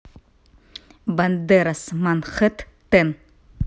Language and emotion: Russian, neutral